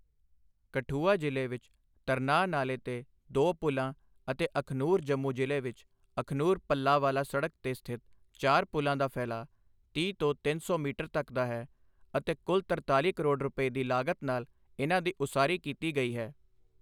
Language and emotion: Punjabi, neutral